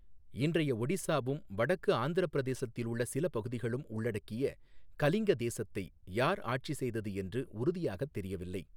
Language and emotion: Tamil, neutral